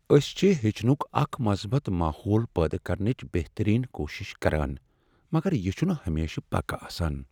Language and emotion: Kashmiri, sad